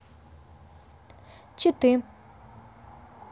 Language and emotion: Russian, neutral